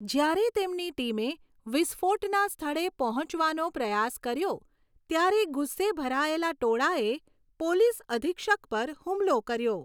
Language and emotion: Gujarati, neutral